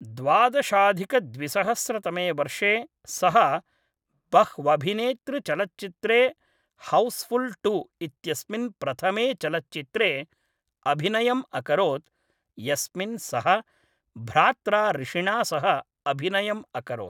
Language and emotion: Sanskrit, neutral